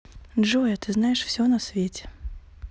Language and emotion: Russian, neutral